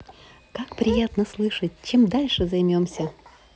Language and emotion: Russian, positive